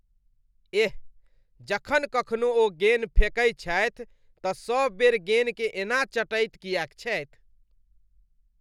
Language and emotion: Maithili, disgusted